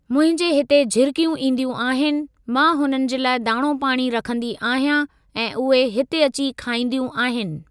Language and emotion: Sindhi, neutral